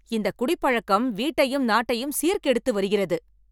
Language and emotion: Tamil, angry